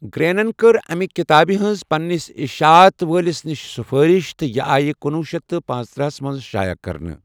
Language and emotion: Kashmiri, neutral